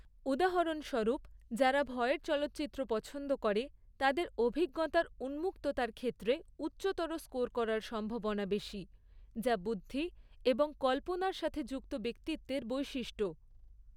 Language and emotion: Bengali, neutral